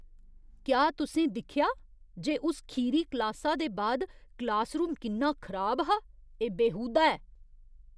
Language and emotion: Dogri, disgusted